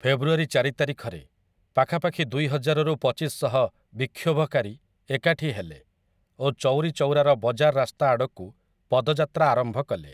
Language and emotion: Odia, neutral